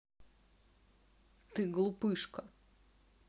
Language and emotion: Russian, angry